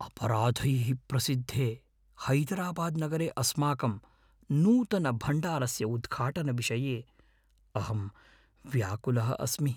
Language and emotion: Sanskrit, fearful